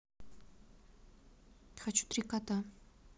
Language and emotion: Russian, neutral